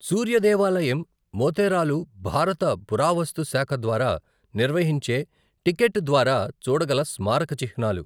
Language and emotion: Telugu, neutral